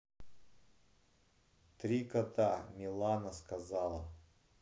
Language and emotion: Russian, neutral